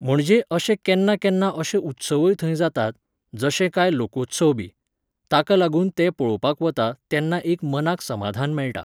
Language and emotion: Goan Konkani, neutral